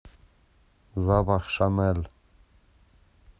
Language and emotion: Russian, positive